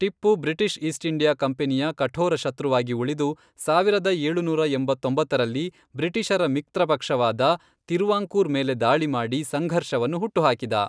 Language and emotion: Kannada, neutral